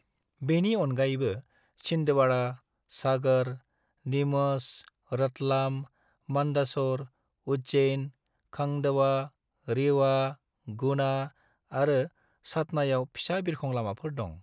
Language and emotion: Bodo, neutral